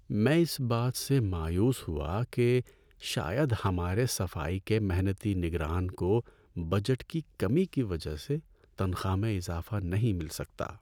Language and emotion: Urdu, sad